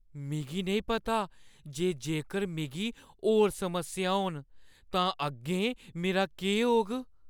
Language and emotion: Dogri, fearful